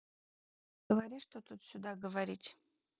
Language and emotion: Russian, neutral